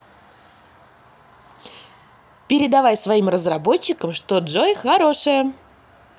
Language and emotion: Russian, positive